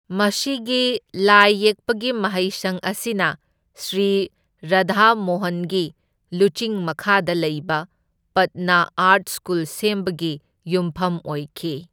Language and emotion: Manipuri, neutral